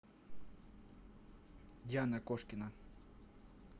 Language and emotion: Russian, neutral